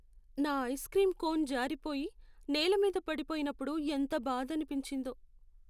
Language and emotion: Telugu, sad